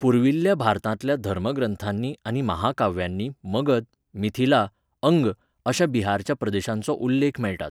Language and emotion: Goan Konkani, neutral